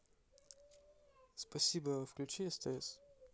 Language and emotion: Russian, neutral